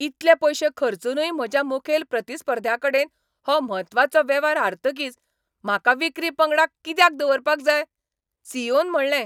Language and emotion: Goan Konkani, angry